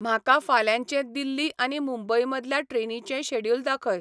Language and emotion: Goan Konkani, neutral